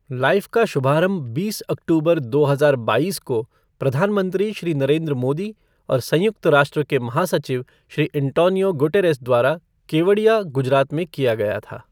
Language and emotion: Hindi, neutral